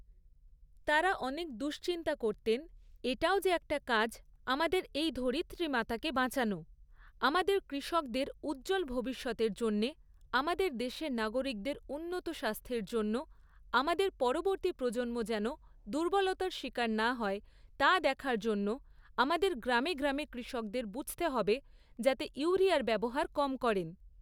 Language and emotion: Bengali, neutral